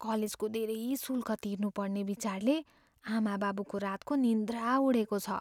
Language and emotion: Nepali, fearful